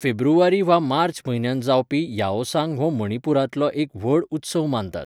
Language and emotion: Goan Konkani, neutral